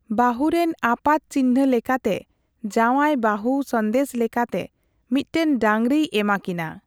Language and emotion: Santali, neutral